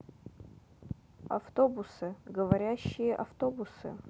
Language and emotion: Russian, neutral